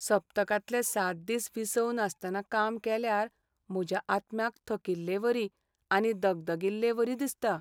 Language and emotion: Goan Konkani, sad